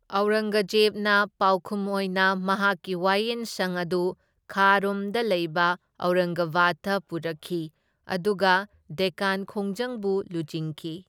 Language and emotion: Manipuri, neutral